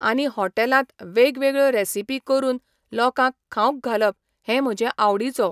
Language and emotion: Goan Konkani, neutral